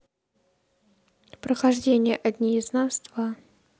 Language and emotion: Russian, neutral